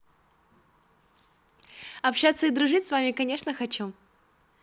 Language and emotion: Russian, positive